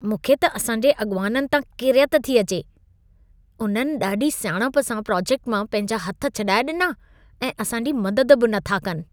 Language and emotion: Sindhi, disgusted